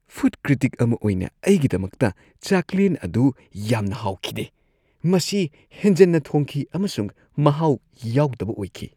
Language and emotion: Manipuri, disgusted